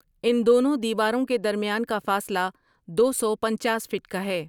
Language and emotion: Urdu, neutral